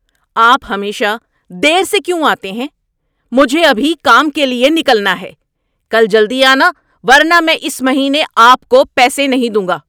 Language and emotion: Urdu, angry